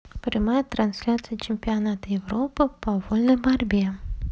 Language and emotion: Russian, neutral